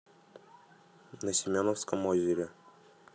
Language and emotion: Russian, neutral